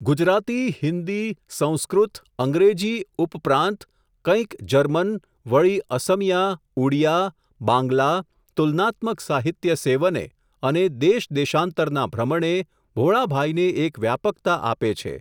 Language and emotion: Gujarati, neutral